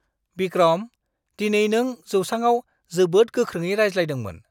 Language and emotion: Bodo, surprised